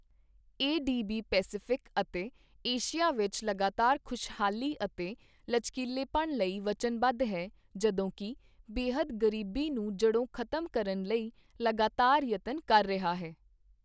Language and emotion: Punjabi, neutral